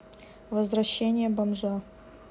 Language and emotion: Russian, neutral